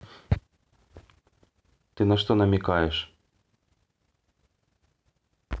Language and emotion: Russian, neutral